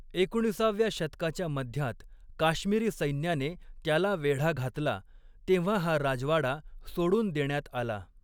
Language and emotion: Marathi, neutral